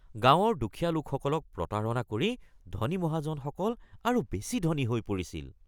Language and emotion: Assamese, disgusted